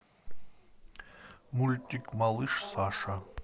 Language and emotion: Russian, neutral